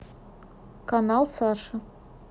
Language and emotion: Russian, neutral